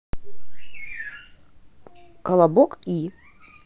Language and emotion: Russian, neutral